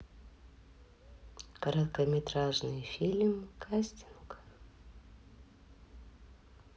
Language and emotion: Russian, neutral